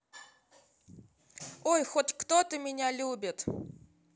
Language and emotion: Russian, positive